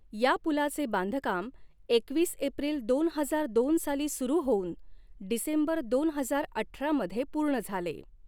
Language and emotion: Marathi, neutral